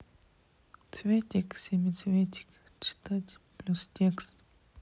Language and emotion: Russian, sad